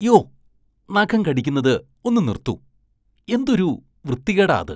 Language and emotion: Malayalam, disgusted